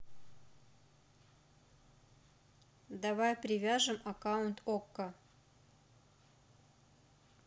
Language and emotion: Russian, neutral